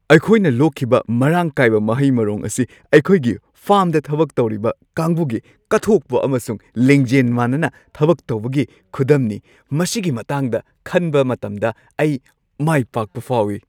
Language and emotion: Manipuri, happy